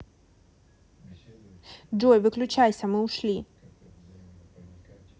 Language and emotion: Russian, neutral